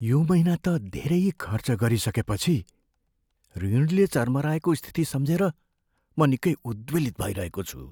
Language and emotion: Nepali, fearful